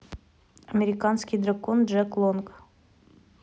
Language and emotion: Russian, neutral